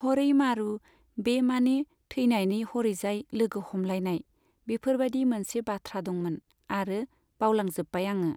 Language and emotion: Bodo, neutral